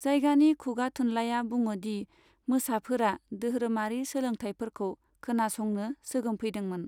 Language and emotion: Bodo, neutral